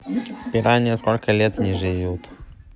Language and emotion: Russian, neutral